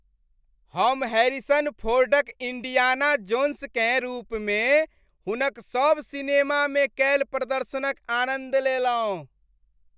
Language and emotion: Maithili, happy